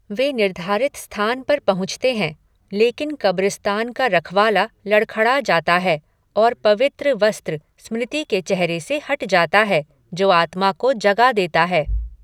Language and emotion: Hindi, neutral